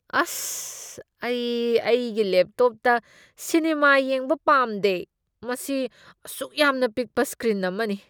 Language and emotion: Manipuri, disgusted